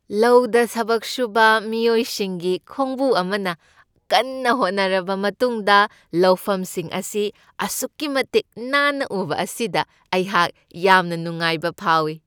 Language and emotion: Manipuri, happy